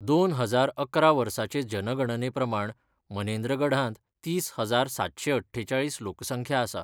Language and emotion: Goan Konkani, neutral